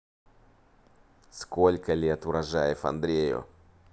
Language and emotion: Russian, neutral